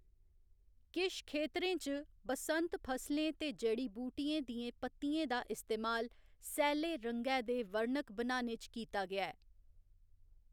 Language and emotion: Dogri, neutral